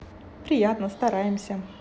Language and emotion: Russian, positive